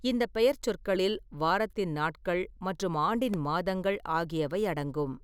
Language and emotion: Tamil, neutral